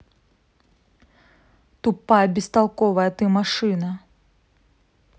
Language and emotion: Russian, angry